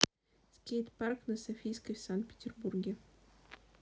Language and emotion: Russian, neutral